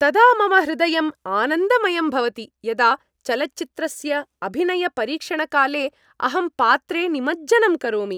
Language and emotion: Sanskrit, happy